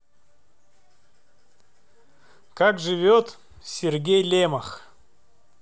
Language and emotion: Russian, neutral